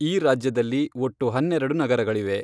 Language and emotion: Kannada, neutral